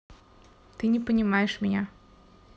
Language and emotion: Russian, sad